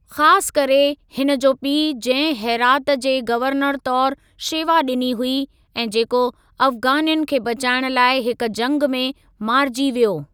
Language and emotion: Sindhi, neutral